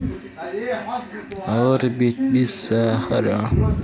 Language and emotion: Russian, neutral